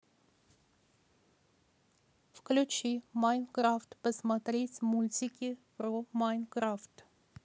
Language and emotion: Russian, neutral